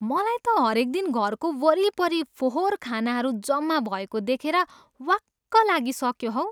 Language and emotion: Nepali, disgusted